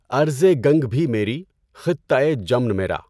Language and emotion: Urdu, neutral